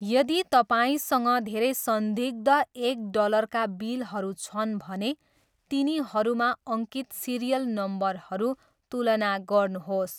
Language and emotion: Nepali, neutral